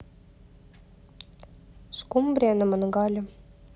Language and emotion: Russian, neutral